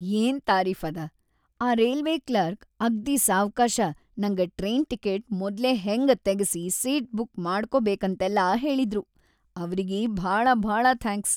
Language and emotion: Kannada, happy